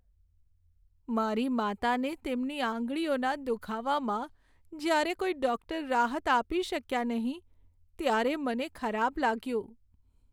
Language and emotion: Gujarati, sad